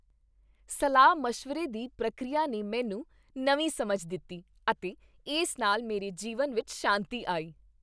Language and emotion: Punjabi, happy